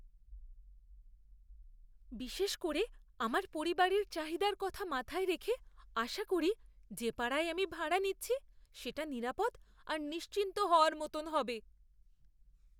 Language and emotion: Bengali, fearful